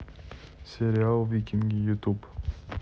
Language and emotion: Russian, neutral